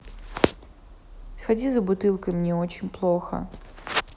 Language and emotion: Russian, sad